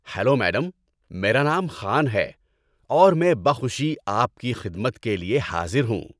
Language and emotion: Urdu, happy